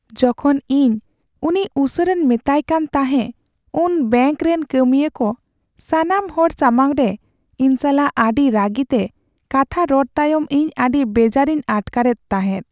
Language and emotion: Santali, sad